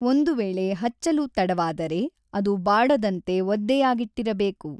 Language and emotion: Kannada, neutral